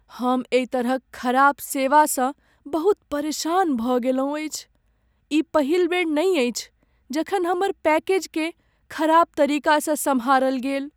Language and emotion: Maithili, sad